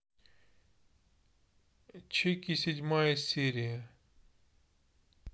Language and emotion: Russian, neutral